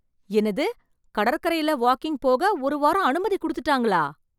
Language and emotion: Tamil, surprised